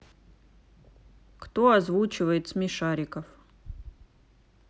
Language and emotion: Russian, neutral